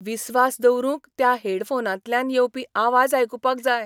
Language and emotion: Goan Konkani, surprised